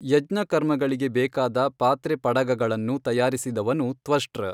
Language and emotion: Kannada, neutral